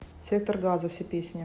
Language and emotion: Russian, neutral